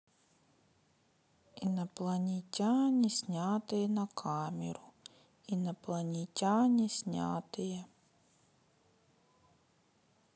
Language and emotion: Russian, sad